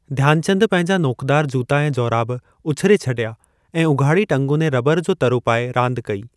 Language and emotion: Sindhi, neutral